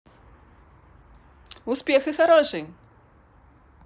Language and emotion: Russian, positive